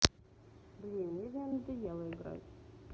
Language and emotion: Russian, neutral